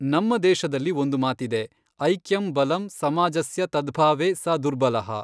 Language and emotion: Kannada, neutral